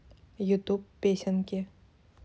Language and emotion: Russian, neutral